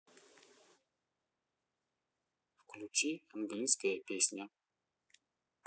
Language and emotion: Russian, neutral